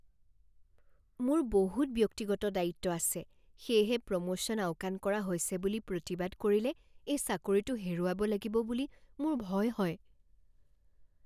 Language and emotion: Assamese, fearful